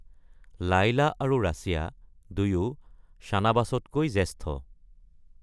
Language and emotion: Assamese, neutral